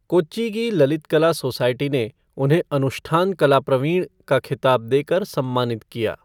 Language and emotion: Hindi, neutral